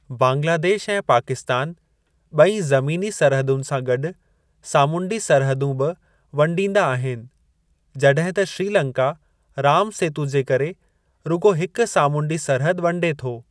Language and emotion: Sindhi, neutral